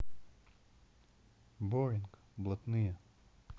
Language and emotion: Russian, neutral